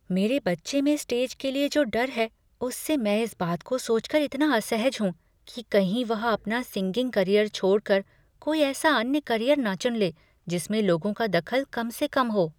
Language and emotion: Hindi, fearful